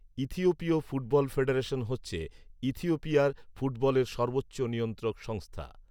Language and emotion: Bengali, neutral